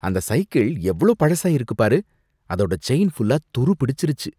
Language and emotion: Tamil, disgusted